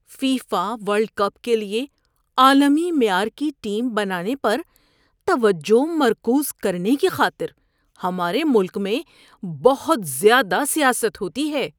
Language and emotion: Urdu, disgusted